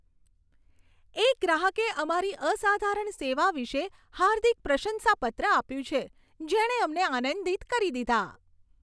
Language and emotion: Gujarati, happy